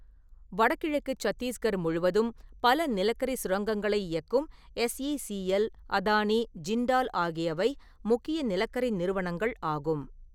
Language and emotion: Tamil, neutral